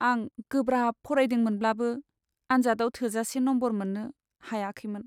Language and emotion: Bodo, sad